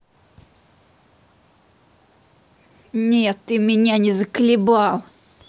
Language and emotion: Russian, angry